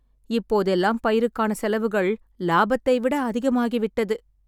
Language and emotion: Tamil, sad